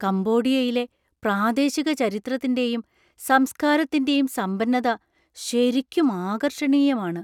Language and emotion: Malayalam, surprised